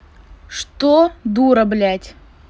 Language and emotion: Russian, angry